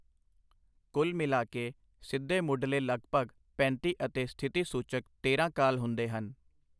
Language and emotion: Punjabi, neutral